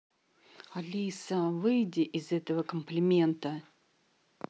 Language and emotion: Russian, angry